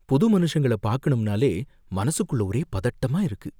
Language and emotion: Tamil, fearful